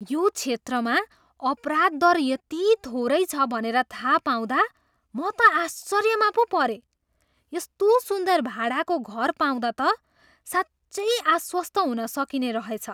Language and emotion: Nepali, surprised